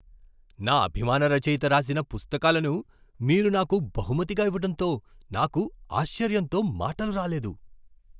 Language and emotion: Telugu, surprised